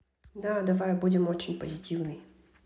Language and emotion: Russian, neutral